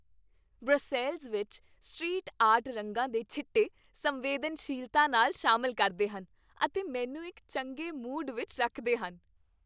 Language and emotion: Punjabi, happy